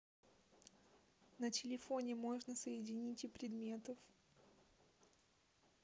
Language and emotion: Russian, neutral